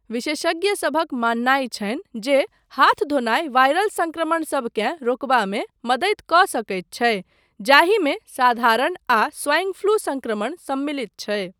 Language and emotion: Maithili, neutral